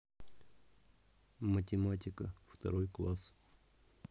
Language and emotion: Russian, neutral